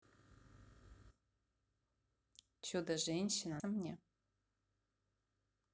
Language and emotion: Russian, neutral